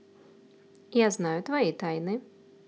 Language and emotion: Russian, neutral